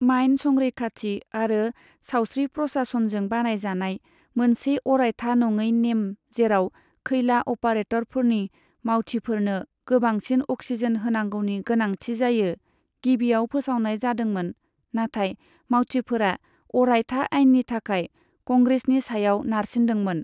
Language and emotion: Bodo, neutral